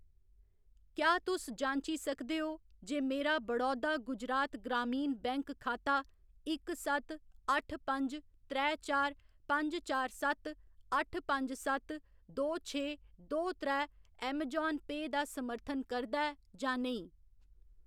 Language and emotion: Dogri, neutral